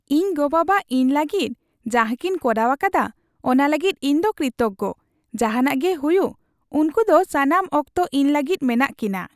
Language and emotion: Santali, happy